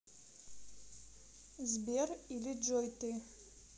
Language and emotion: Russian, neutral